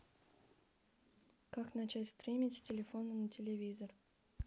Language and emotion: Russian, neutral